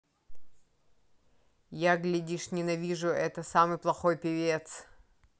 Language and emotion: Russian, neutral